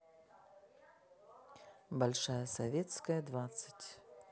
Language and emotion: Russian, neutral